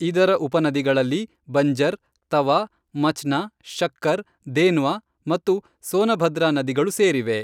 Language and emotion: Kannada, neutral